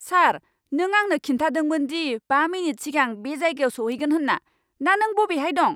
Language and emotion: Bodo, angry